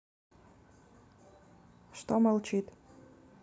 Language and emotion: Russian, neutral